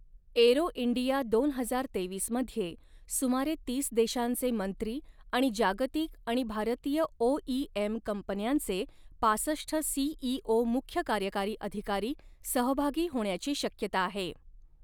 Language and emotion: Marathi, neutral